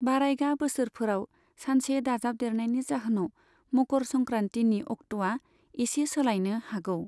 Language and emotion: Bodo, neutral